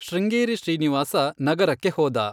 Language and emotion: Kannada, neutral